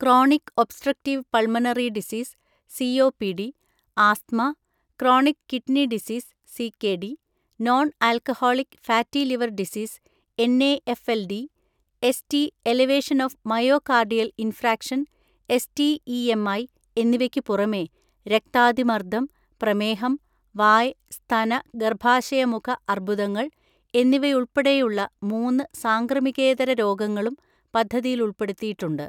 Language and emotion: Malayalam, neutral